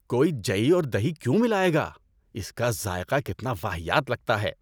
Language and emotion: Urdu, disgusted